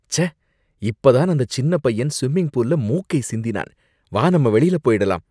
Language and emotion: Tamil, disgusted